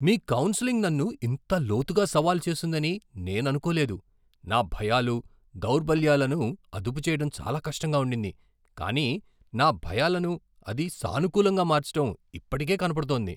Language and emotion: Telugu, surprised